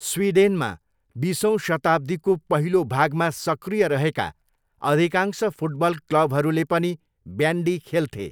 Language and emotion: Nepali, neutral